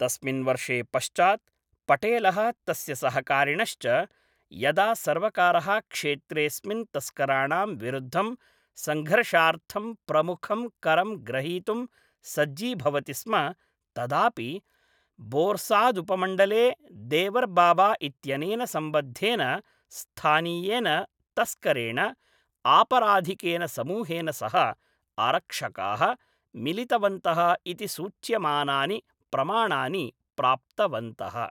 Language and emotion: Sanskrit, neutral